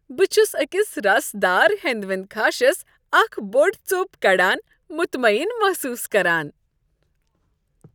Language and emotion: Kashmiri, happy